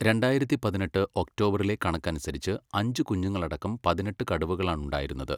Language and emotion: Malayalam, neutral